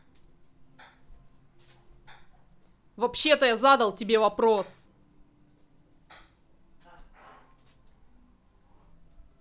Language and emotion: Russian, angry